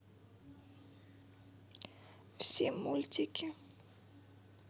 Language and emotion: Russian, sad